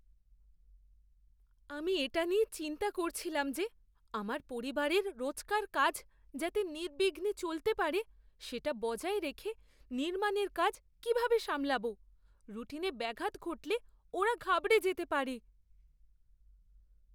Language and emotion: Bengali, fearful